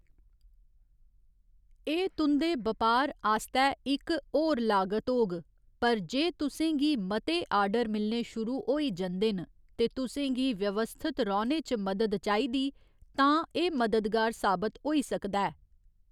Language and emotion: Dogri, neutral